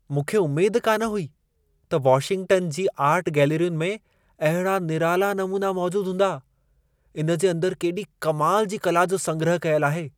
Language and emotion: Sindhi, surprised